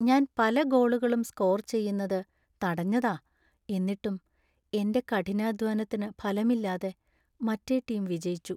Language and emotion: Malayalam, sad